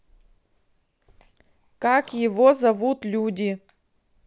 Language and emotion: Russian, neutral